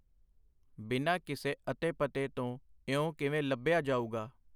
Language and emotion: Punjabi, neutral